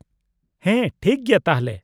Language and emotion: Santali, neutral